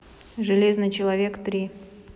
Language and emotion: Russian, neutral